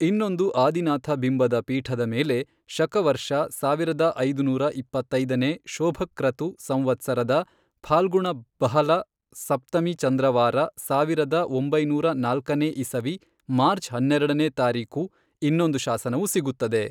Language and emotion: Kannada, neutral